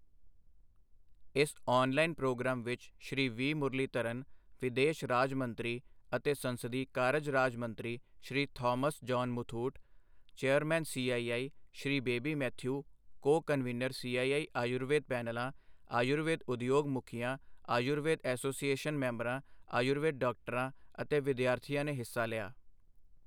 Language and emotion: Punjabi, neutral